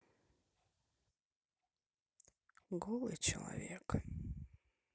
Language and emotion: Russian, sad